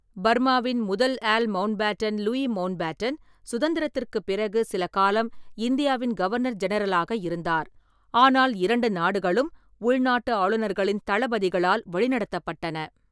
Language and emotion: Tamil, neutral